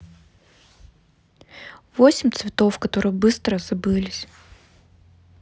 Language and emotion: Russian, neutral